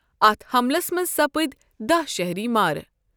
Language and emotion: Kashmiri, neutral